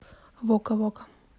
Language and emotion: Russian, neutral